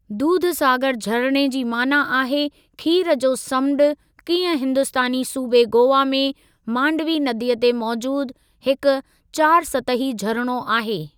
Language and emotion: Sindhi, neutral